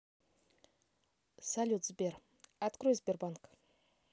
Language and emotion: Russian, neutral